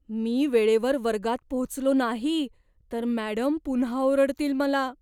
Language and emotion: Marathi, fearful